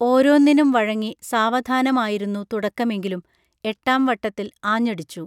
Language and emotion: Malayalam, neutral